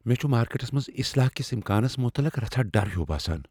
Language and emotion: Kashmiri, fearful